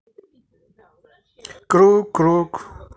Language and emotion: Russian, neutral